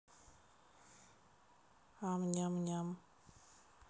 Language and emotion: Russian, neutral